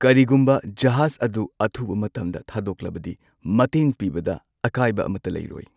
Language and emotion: Manipuri, neutral